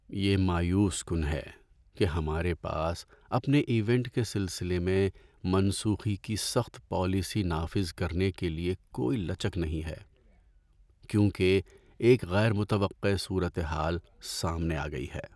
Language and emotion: Urdu, sad